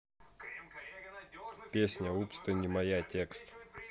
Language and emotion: Russian, neutral